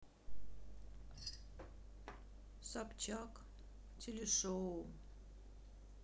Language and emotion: Russian, sad